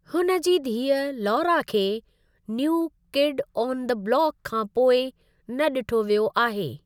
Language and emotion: Sindhi, neutral